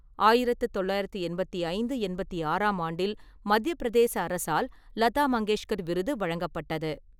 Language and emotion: Tamil, neutral